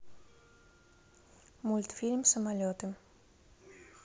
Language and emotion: Russian, neutral